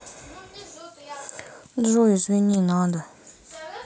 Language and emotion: Russian, sad